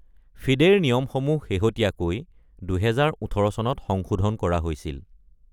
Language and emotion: Assamese, neutral